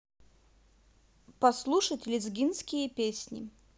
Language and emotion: Russian, neutral